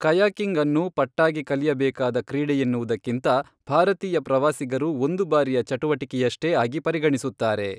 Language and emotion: Kannada, neutral